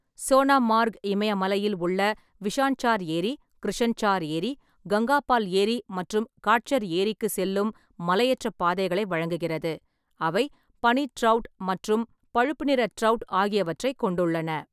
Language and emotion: Tamil, neutral